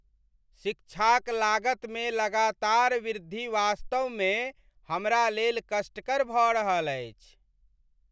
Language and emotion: Maithili, sad